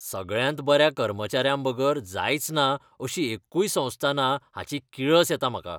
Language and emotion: Goan Konkani, disgusted